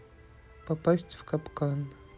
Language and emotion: Russian, neutral